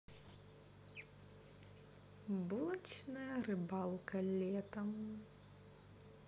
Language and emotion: Russian, neutral